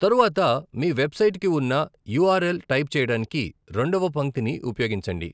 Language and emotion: Telugu, neutral